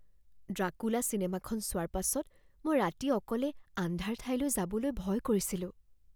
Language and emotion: Assamese, fearful